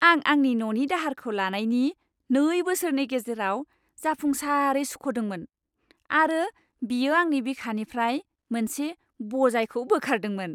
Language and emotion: Bodo, happy